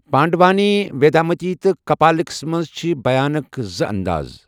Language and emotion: Kashmiri, neutral